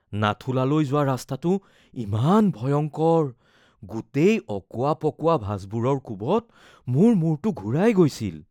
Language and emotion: Assamese, fearful